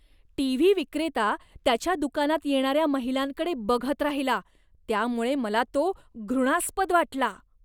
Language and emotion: Marathi, disgusted